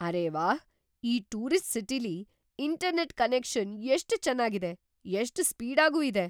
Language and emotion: Kannada, surprised